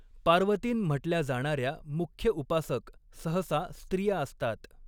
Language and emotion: Marathi, neutral